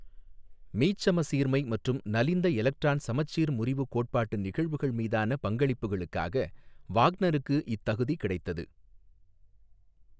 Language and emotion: Tamil, neutral